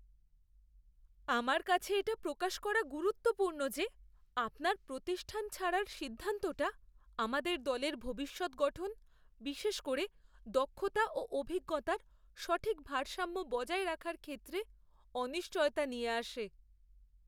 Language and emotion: Bengali, fearful